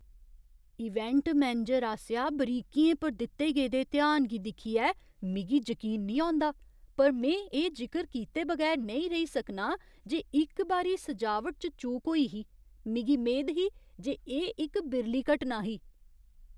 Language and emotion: Dogri, surprised